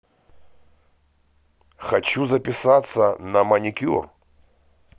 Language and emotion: Russian, neutral